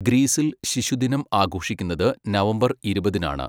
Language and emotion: Malayalam, neutral